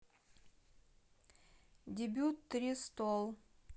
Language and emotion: Russian, neutral